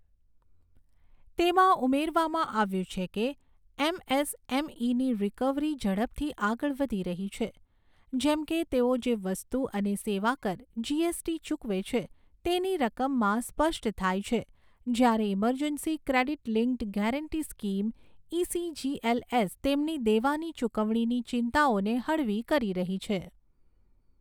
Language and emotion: Gujarati, neutral